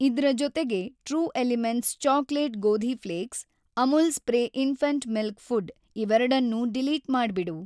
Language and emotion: Kannada, neutral